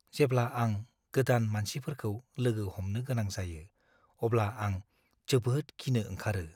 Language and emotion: Bodo, fearful